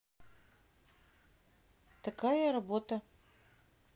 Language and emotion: Russian, neutral